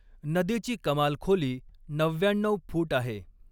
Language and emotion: Marathi, neutral